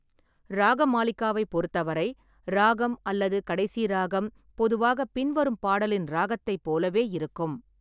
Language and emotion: Tamil, neutral